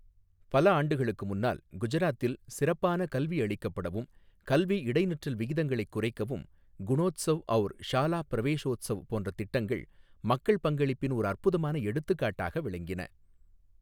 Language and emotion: Tamil, neutral